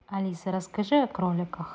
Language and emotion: Russian, neutral